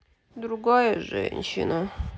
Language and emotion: Russian, sad